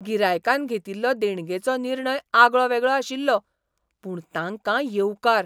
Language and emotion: Goan Konkani, surprised